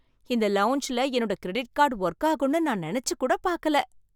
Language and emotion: Tamil, surprised